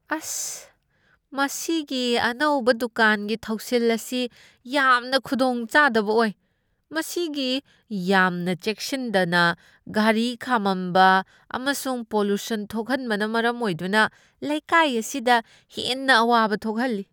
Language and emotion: Manipuri, disgusted